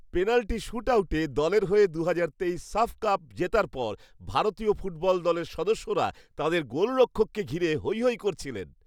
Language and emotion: Bengali, happy